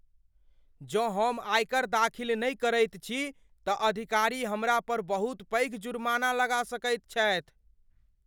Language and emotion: Maithili, fearful